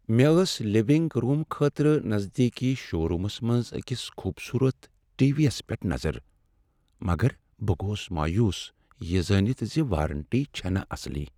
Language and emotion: Kashmiri, sad